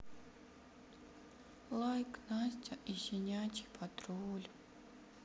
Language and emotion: Russian, sad